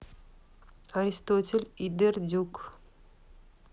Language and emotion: Russian, neutral